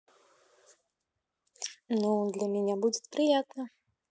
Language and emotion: Russian, positive